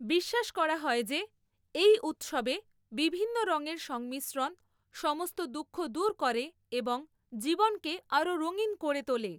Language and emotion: Bengali, neutral